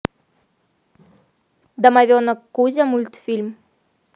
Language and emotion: Russian, neutral